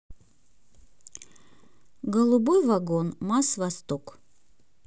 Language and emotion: Russian, neutral